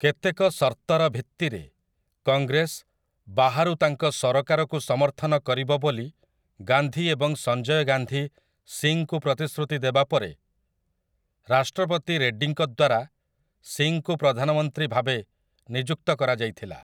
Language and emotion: Odia, neutral